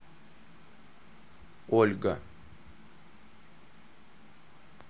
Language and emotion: Russian, neutral